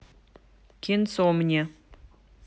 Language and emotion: Russian, neutral